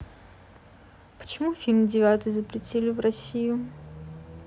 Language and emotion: Russian, neutral